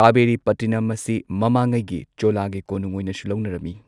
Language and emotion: Manipuri, neutral